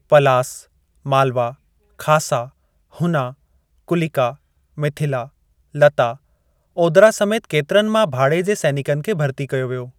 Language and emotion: Sindhi, neutral